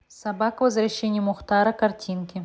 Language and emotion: Russian, neutral